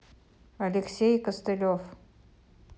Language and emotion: Russian, neutral